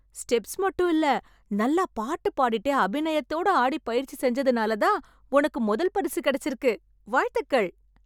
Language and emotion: Tamil, happy